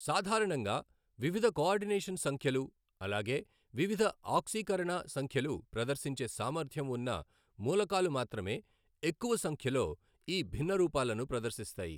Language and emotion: Telugu, neutral